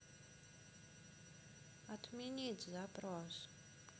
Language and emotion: Russian, neutral